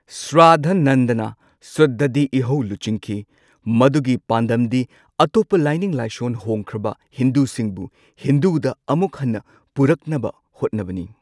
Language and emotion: Manipuri, neutral